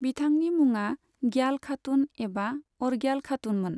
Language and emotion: Bodo, neutral